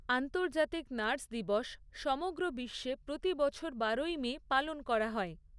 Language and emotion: Bengali, neutral